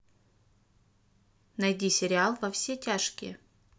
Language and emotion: Russian, neutral